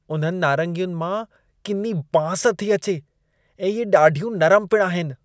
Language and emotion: Sindhi, disgusted